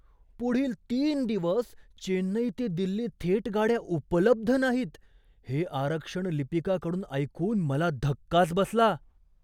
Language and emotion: Marathi, surprised